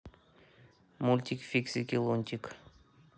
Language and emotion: Russian, neutral